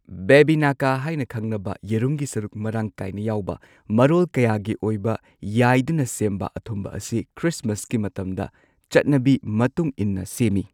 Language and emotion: Manipuri, neutral